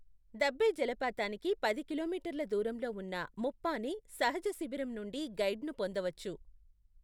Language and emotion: Telugu, neutral